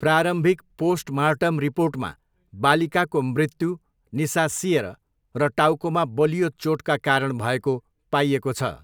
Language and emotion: Nepali, neutral